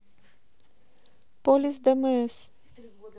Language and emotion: Russian, neutral